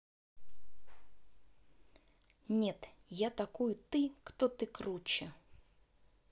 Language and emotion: Russian, neutral